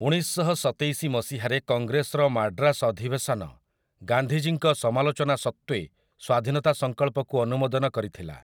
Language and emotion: Odia, neutral